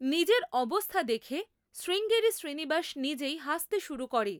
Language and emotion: Bengali, neutral